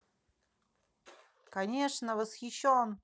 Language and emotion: Russian, positive